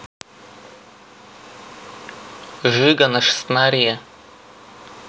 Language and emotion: Russian, neutral